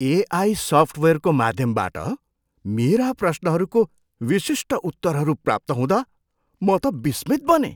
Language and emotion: Nepali, surprised